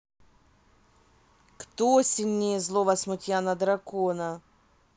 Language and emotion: Russian, neutral